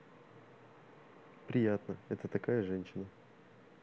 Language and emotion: Russian, neutral